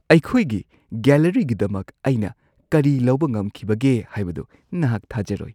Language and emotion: Manipuri, surprised